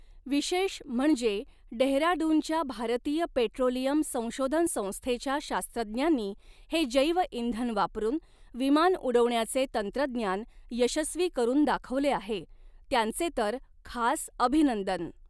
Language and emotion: Marathi, neutral